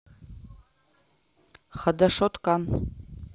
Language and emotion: Russian, neutral